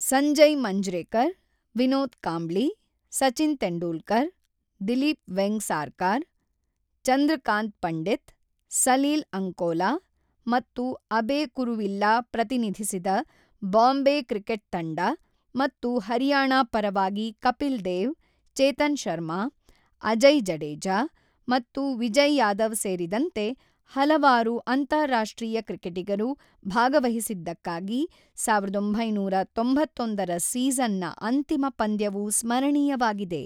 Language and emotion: Kannada, neutral